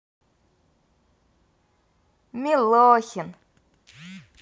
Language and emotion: Russian, positive